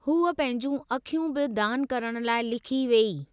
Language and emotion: Sindhi, neutral